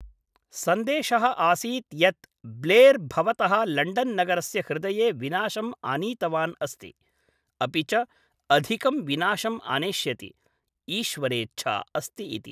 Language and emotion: Sanskrit, neutral